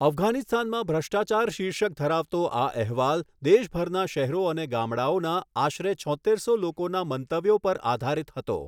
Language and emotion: Gujarati, neutral